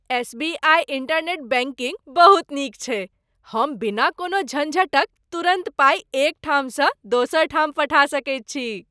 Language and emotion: Maithili, happy